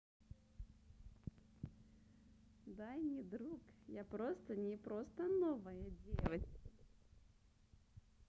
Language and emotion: Russian, positive